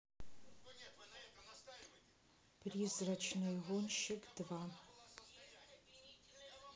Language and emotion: Russian, neutral